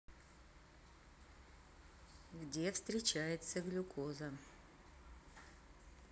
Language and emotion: Russian, neutral